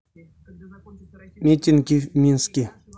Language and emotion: Russian, neutral